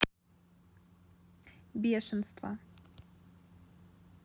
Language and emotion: Russian, neutral